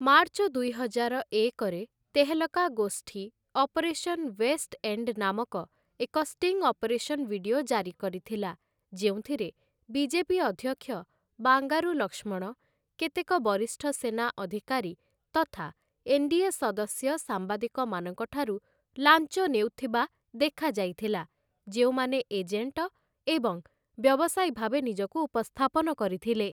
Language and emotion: Odia, neutral